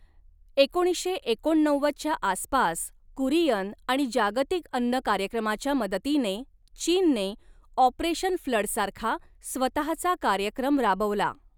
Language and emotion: Marathi, neutral